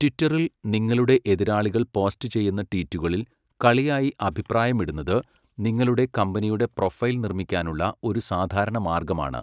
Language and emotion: Malayalam, neutral